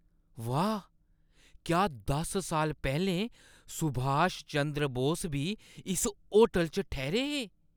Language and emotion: Dogri, surprised